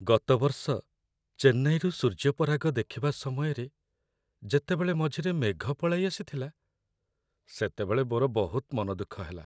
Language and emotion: Odia, sad